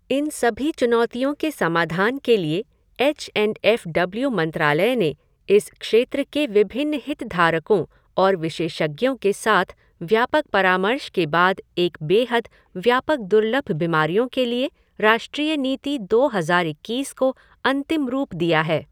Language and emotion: Hindi, neutral